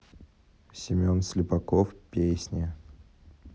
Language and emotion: Russian, neutral